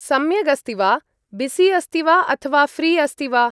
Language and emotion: Sanskrit, neutral